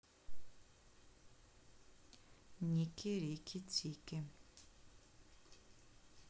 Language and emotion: Russian, neutral